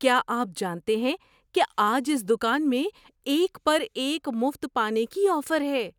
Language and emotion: Urdu, surprised